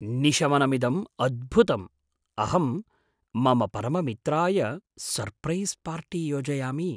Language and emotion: Sanskrit, surprised